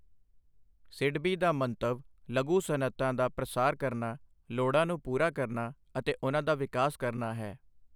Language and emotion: Punjabi, neutral